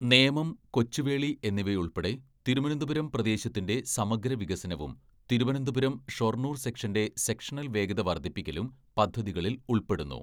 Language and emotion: Malayalam, neutral